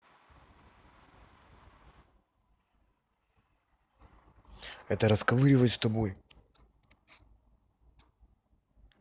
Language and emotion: Russian, angry